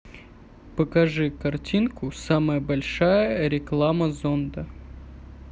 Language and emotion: Russian, neutral